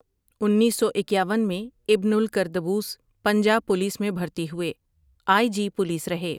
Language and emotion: Urdu, neutral